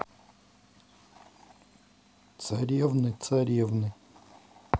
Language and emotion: Russian, neutral